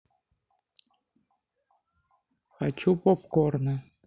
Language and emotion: Russian, neutral